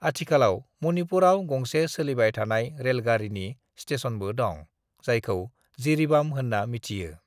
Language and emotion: Bodo, neutral